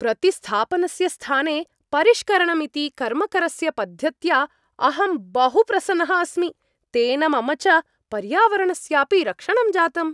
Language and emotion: Sanskrit, happy